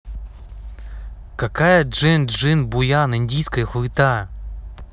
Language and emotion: Russian, angry